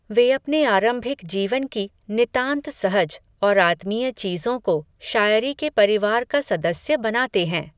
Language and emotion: Hindi, neutral